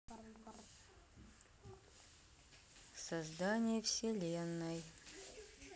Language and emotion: Russian, neutral